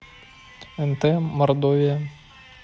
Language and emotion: Russian, neutral